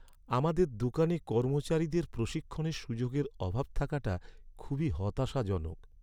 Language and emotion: Bengali, sad